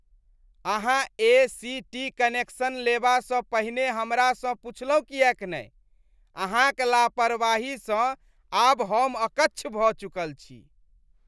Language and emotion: Maithili, disgusted